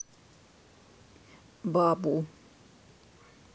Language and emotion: Russian, neutral